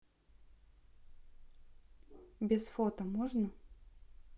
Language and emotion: Russian, neutral